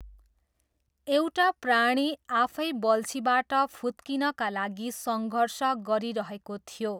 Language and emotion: Nepali, neutral